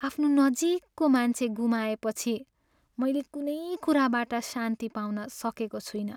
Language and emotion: Nepali, sad